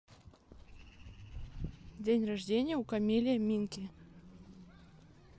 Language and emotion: Russian, neutral